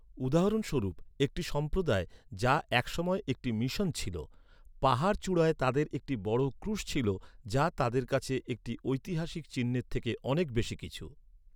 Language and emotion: Bengali, neutral